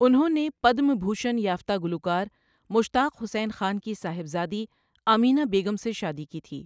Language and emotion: Urdu, neutral